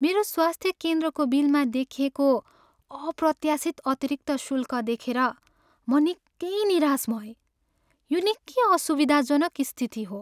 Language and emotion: Nepali, sad